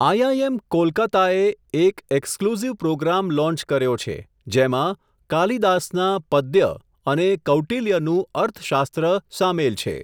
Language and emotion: Gujarati, neutral